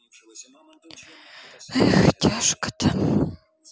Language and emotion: Russian, sad